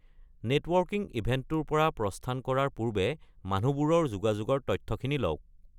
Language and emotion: Assamese, neutral